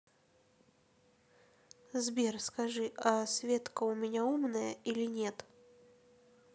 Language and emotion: Russian, neutral